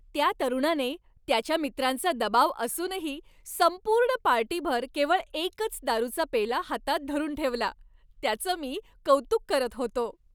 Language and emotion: Marathi, happy